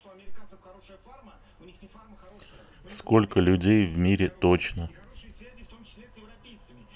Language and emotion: Russian, neutral